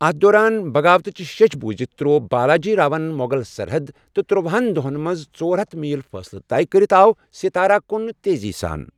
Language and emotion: Kashmiri, neutral